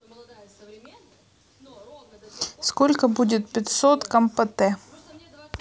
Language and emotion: Russian, neutral